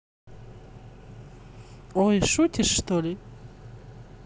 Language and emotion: Russian, neutral